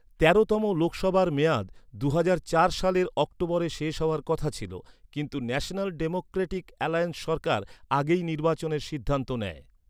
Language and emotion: Bengali, neutral